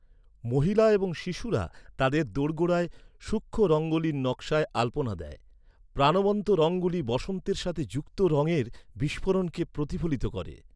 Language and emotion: Bengali, neutral